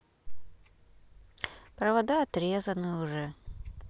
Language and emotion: Russian, sad